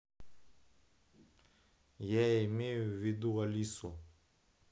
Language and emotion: Russian, neutral